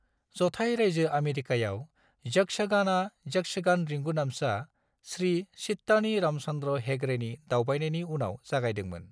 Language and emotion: Bodo, neutral